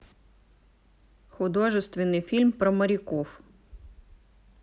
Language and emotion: Russian, neutral